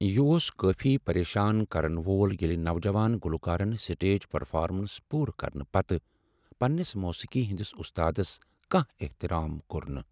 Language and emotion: Kashmiri, sad